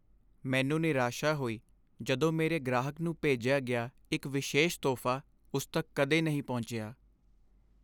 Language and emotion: Punjabi, sad